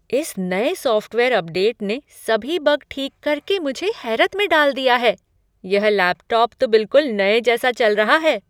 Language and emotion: Hindi, surprised